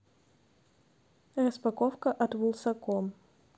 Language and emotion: Russian, neutral